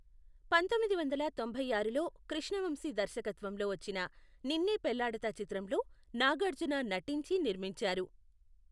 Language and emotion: Telugu, neutral